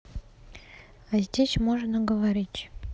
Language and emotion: Russian, neutral